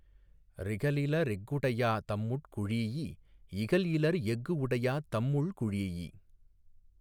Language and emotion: Tamil, neutral